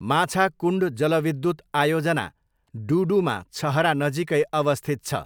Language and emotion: Nepali, neutral